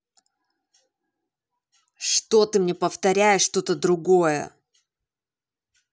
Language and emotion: Russian, angry